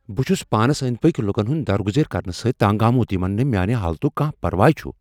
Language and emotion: Kashmiri, angry